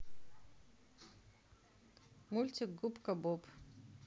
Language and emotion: Russian, neutral